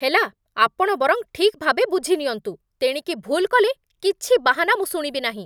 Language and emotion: Odia, angry